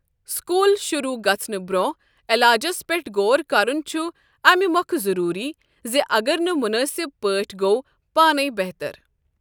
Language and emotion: Kashmiri, neutral